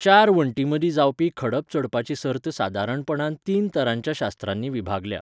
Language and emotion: Goan Konkani, neutral